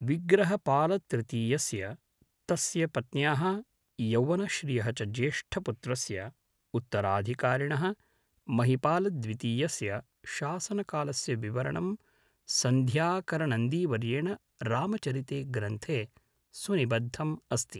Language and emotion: Sanskrit, neutral